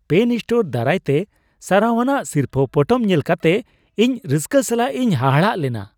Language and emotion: Santali, surprised